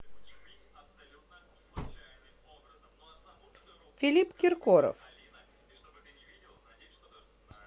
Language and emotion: Russian, neutral